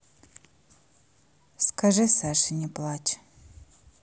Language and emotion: Russian, neutral